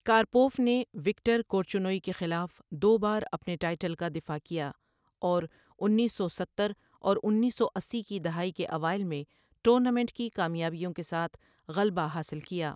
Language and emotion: Urdu, neutral